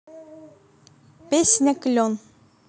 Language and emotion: Russian, positive